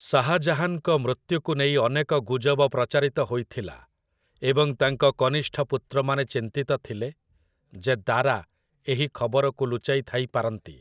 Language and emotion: Odia, neutral